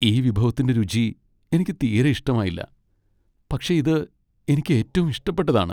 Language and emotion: Malayalam, sad